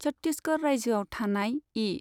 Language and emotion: Bodo, neutral